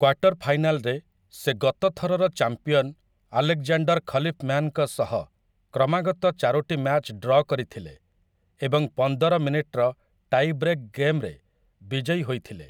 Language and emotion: Odia, neutral